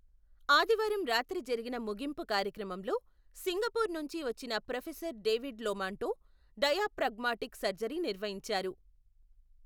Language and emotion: Telugu, neutral